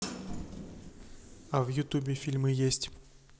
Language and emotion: Russian, neutral